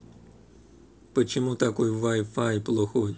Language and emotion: Russian, neutral